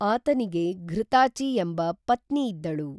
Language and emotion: Kannada, neutral